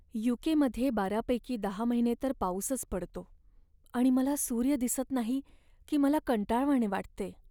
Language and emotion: Marathi, sad